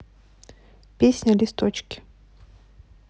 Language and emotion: Russian, neutral